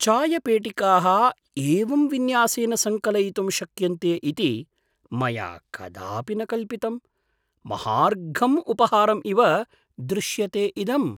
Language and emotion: Sanskrit, surprised